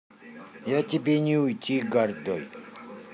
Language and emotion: Russian, neutral